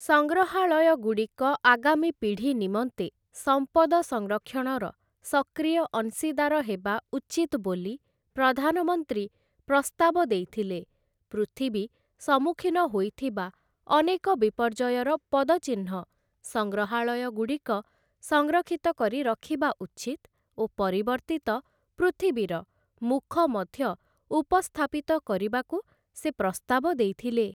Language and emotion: Odia, neutral